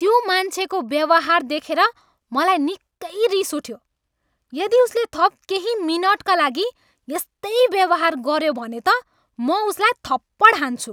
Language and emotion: Nepali, angry